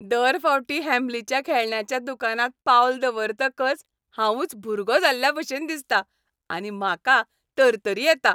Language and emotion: Goan Konkani, happy